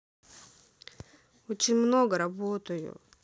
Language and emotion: Russian, sad